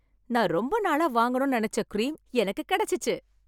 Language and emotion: Tamil, happy